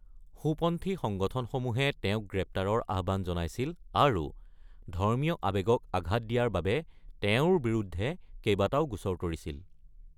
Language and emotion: Assamese, neutral